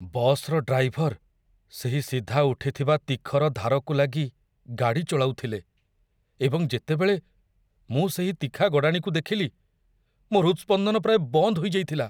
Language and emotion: Odia, fearful